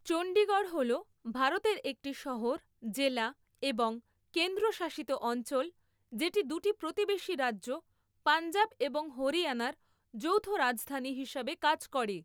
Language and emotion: Bengali, neutral